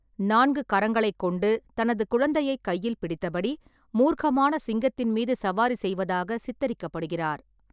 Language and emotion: Tamil, neutral